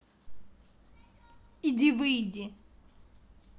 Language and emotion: Russian, angry